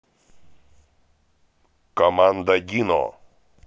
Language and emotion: Russian, positive